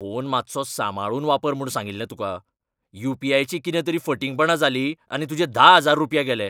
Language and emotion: Goan Konkani, angry